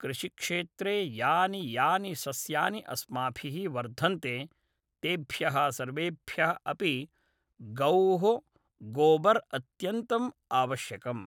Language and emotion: Sanskrit, neutral